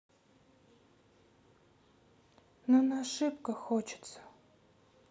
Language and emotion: Russian, sad